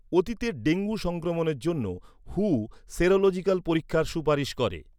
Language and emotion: Bengali, neutral